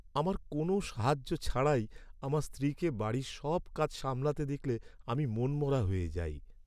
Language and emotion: Bengali, sad